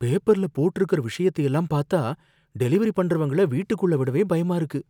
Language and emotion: Tamil, fearful